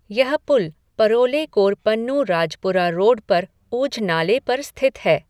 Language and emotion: Hindi, neutral